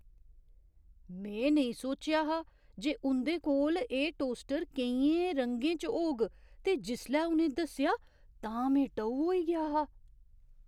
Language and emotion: Dogri, surprised